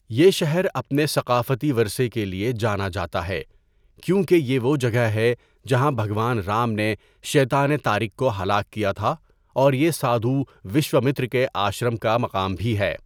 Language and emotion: Urdu, neutral